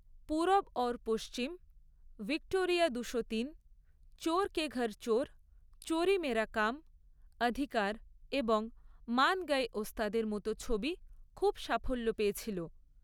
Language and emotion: Bengali, neutral